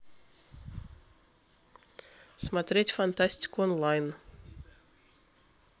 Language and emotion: Russian, neutral